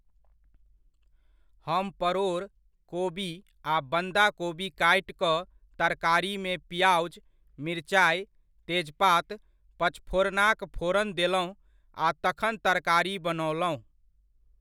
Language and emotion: Maithili, neutral